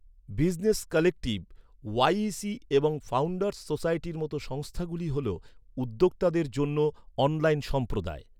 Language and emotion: Bengali, neutral